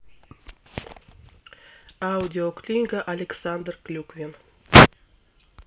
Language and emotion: Russian, neutral